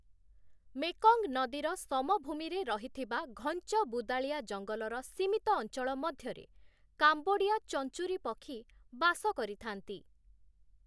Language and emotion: Odia, neutral